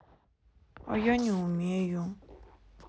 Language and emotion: Russian, sad